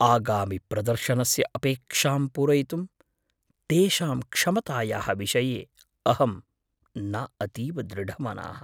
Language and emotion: Sanskrit, fearful